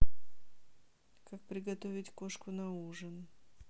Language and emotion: Russian, neutral